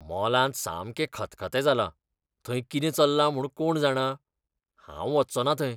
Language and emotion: Goan Konkani, disgusted